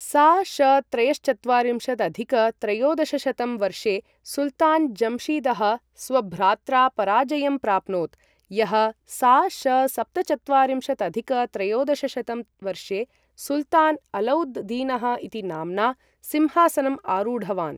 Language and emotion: Sanskrit, neutral